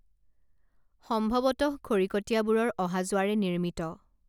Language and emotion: Assamese, neutral